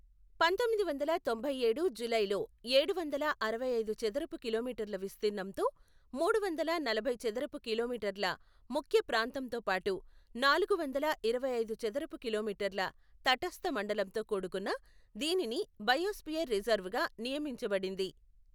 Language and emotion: Telugu, neutral